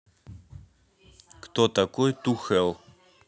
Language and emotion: Russian, neutral